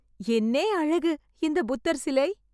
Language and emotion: Tamil, surprised